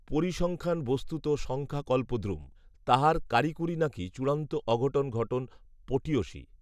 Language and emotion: Bengali, neutral